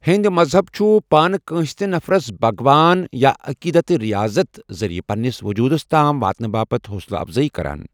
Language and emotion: Kashmiri, neutral